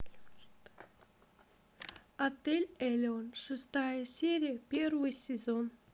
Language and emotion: Russian, neutral